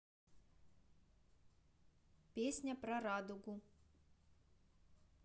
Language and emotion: Russian, neutral